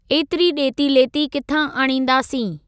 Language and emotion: Sindhi, neutral